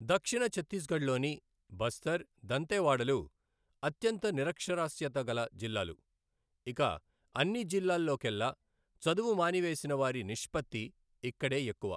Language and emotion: Telugu, neutral